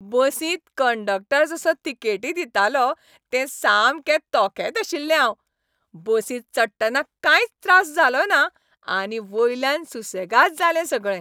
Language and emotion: Goan Konkani, happy